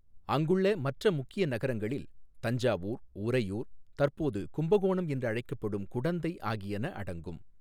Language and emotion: Tamil, neutral